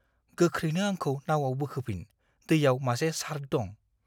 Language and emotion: Bodo, fearful